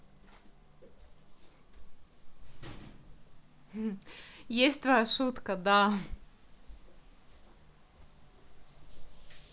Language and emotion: Russian, positive